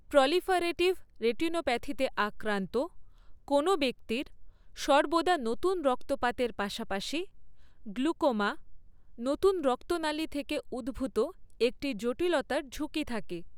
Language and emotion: Bengali, neutral